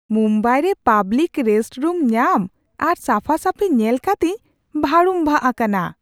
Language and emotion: Santali, surprised